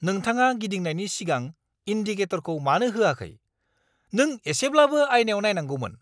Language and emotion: Bodo, angry